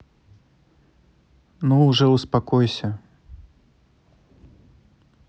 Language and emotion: Russian, neutral